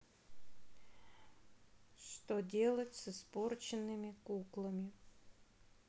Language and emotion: Russian, sad